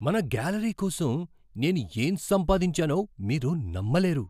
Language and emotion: Telugu, surprised